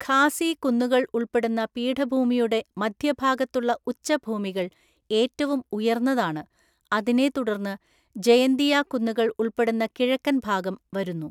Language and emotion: Malayalam, neutral